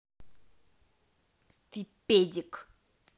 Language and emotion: Russian, angry